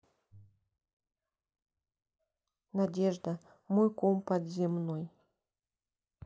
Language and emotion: Russian, sad